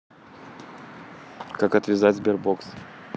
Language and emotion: Russian, neutral